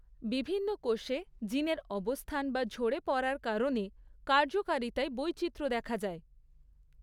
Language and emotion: Bengali, neutral